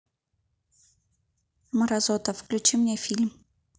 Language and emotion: Russian, angry